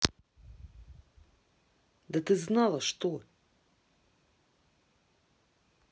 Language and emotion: Russian, angry